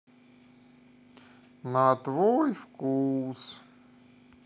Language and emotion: Russian, sad